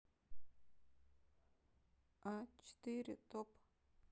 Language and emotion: Russian, neutral